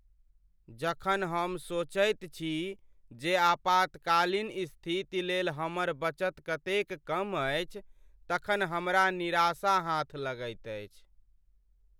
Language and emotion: Maithili, sad